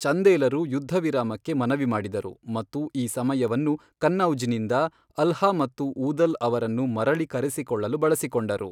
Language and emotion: Kannada, neutral